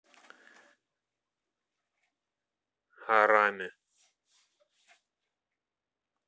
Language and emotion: Russian, neutral